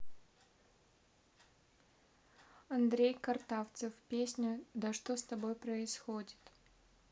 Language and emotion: Russian, neutral